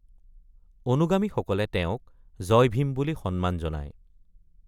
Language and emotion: Assamese, neutral